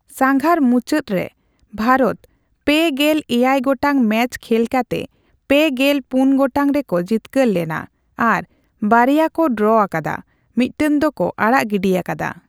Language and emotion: Santali, neutral